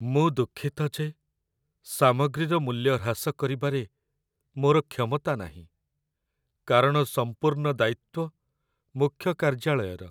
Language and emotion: Odia, sad